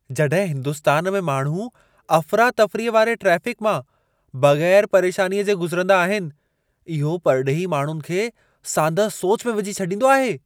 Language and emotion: Sindhi, surprised